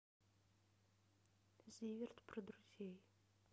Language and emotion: Russian, neutral